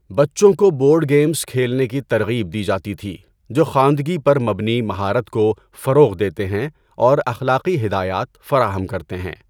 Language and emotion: Urdu, neutral